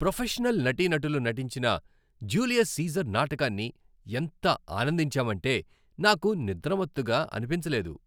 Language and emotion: Telugu, happy